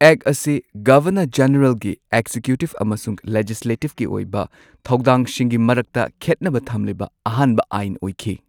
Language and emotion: Manipuri, neutral